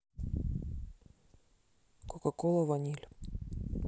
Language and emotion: Russian, neutral